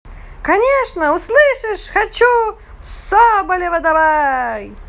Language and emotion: Russian, positive